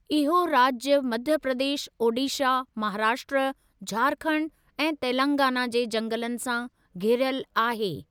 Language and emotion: Sindhi, neutral